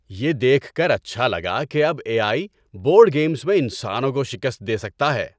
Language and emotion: Urdu, happy